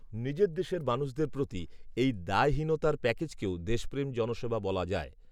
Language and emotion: Bengali, neutral